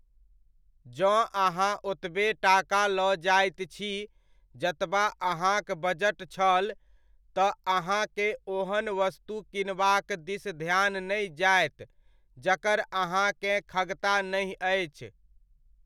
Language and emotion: Maithili, neutral